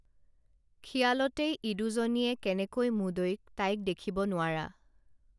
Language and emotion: Assamese, neutral